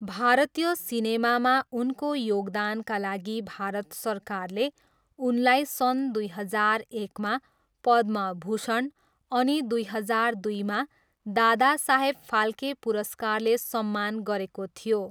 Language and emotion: Nepali, neutral